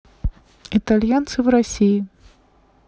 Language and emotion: Russian, neutral